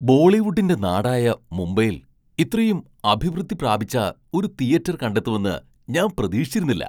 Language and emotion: Malayalam, surprised